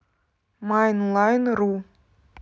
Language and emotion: Russian, neutral